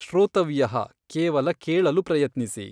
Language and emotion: Kannada, neutral